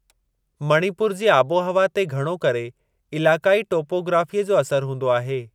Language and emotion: Sindhi, neutral